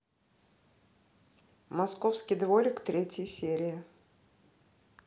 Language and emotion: Russian, neutral